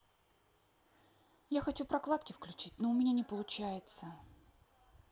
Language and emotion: Russian, sad